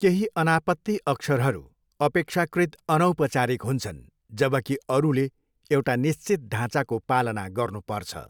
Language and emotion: Nepali, neutral